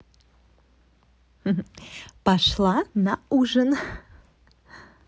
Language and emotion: Russian, positive